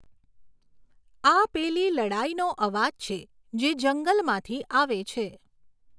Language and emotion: Gujarati, neutral